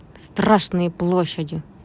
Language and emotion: Russian, angry